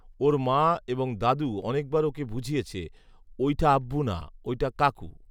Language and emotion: Bengali, neutral